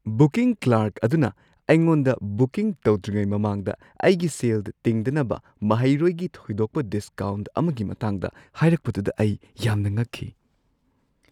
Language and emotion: Manipuri, surprised